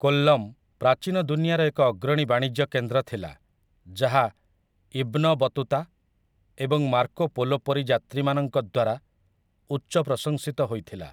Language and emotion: Odia, neutral